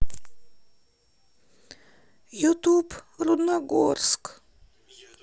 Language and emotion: Russian, sad